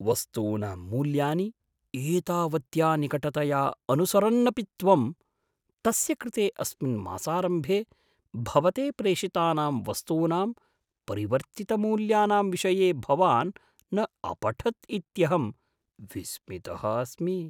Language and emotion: Sanskrit, surprised